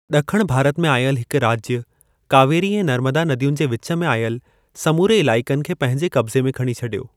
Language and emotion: Sindhi, neutral